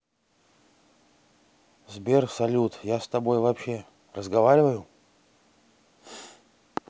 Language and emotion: Russian, sad